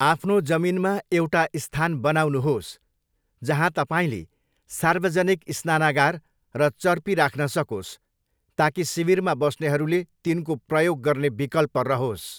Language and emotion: Nepali, neutral